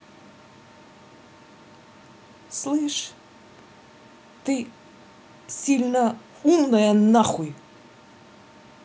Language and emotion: Russian, angry